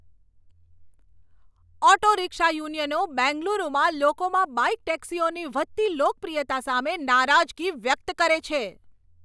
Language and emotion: Gujarati, angry